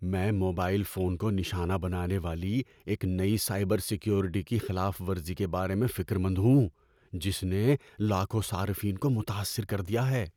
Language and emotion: Urdu, fearful